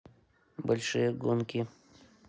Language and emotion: Russian, neutral